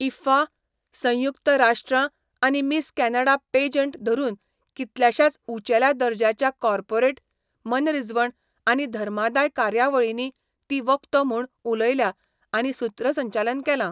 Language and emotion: Goan Konkani, neutral